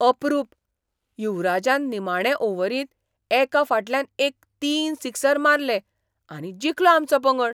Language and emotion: Goan Konkani, surprised